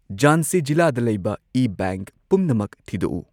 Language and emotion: Manipuri, neutral